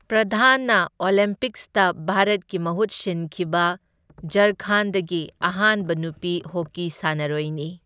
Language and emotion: Manipuri, neutral